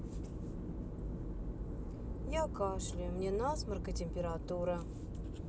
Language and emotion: Russian, sad